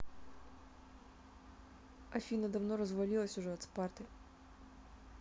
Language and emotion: Russian, neutral